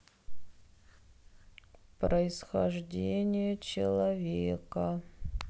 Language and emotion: Russian, sad